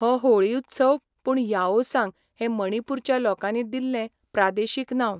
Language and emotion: Goan Konkani, neutral